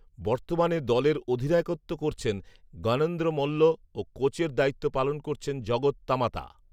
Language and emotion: Bengali, neutral